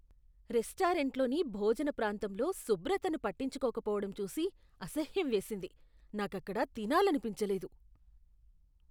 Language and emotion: Telugu, disgusted